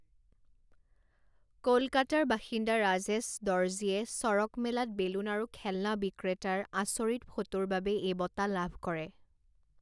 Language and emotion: Assamese, neutral